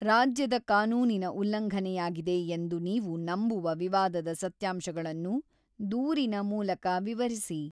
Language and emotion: Kannada, neutral